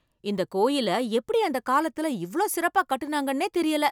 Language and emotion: Tamil, surprised